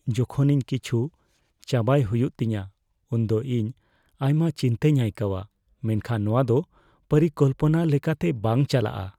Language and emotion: Santali, fearful